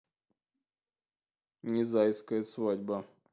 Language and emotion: Russian, neutral